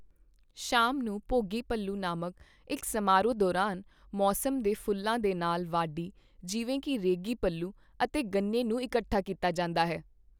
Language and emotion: Punjabi, neutral